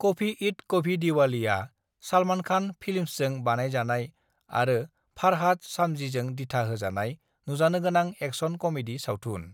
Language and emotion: Bodo, neutral